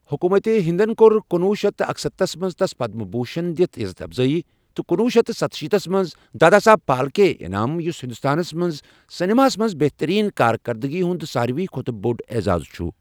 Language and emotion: Kashmiri, neutral